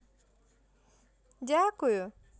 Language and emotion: Russian, positive